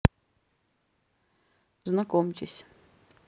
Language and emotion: Russian, neutral